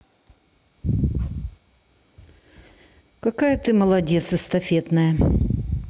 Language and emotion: Russian, neutral